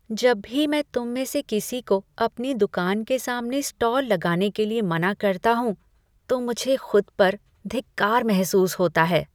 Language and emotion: Hindi, disgusted